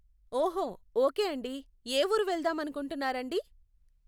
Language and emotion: Telugu, neutral